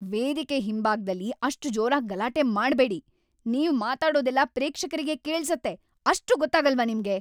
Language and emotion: Kannada, angry